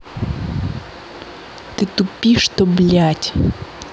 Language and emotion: Russian, angry